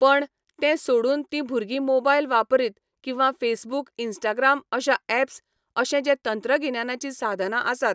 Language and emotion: Goan Konkani, neutral